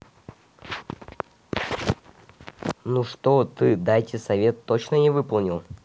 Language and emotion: Russian, neutral